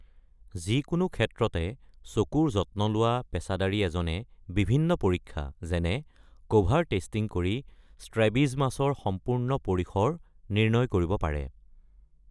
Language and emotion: Assamese, neutral